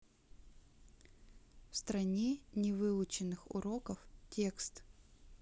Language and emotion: Russian, neutral